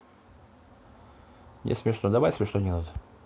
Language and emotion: Russian, neutral